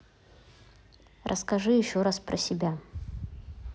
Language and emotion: Russian, neutral